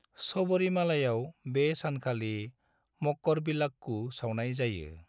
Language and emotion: Bodo, neutral